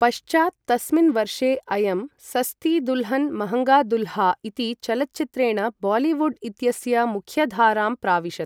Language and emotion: Sanskrit, neutral